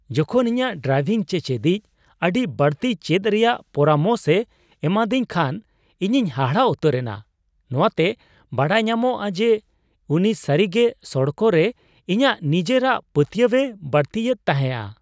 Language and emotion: Santali, surprised